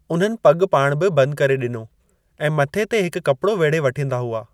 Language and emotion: Sindhi, neutral